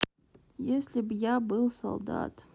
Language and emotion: Russian, sad